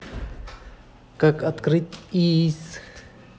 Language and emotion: Russian, neutral